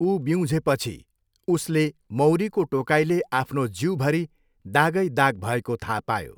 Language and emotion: Nepali, neutral